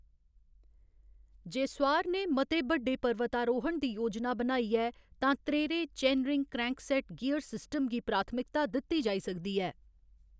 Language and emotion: Dogri, neutral